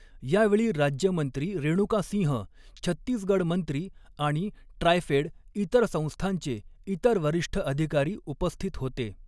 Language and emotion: Marathi, neutral